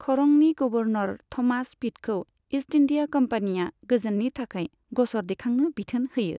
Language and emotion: Bodo, neutral